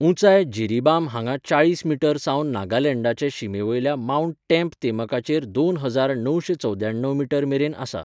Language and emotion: Goan Konkani, neutral